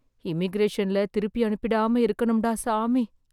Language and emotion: Tamil, fearful